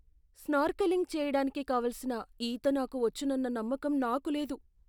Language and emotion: Telugu, fearful